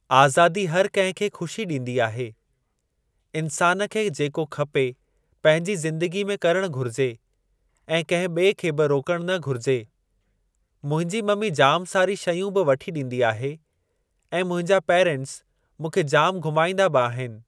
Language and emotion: Sindhi, neutral